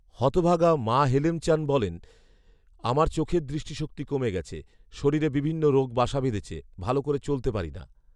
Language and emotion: Bengali, neutral